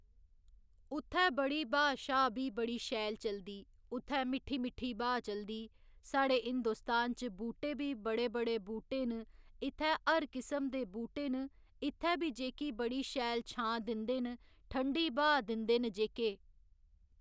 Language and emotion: Dogri, neutral